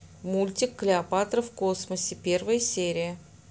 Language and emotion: Russian, neutral